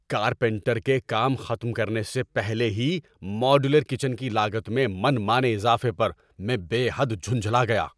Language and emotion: Urdu, angry